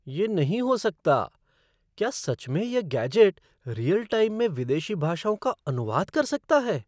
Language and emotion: Hindi, surprised